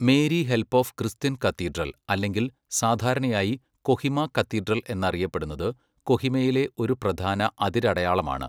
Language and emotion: Malayalam, neutral